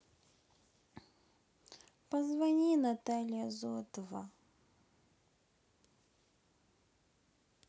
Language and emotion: Russian, sad